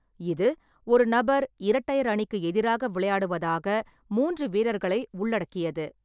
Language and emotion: Tamil, neutral